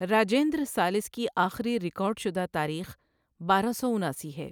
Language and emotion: Urdu, neutral